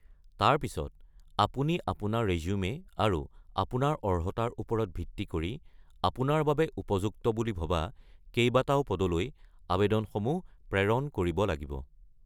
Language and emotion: Assamese, neutral